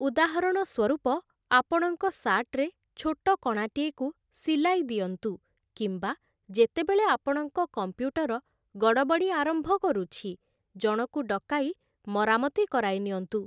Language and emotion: Odia, neutral